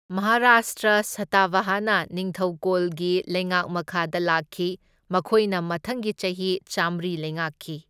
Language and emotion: Manipuri, neutral